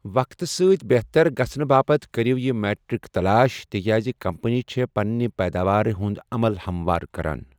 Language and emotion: Kashmiri, neutral